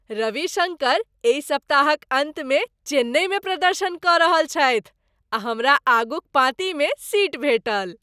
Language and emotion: Maithili, happy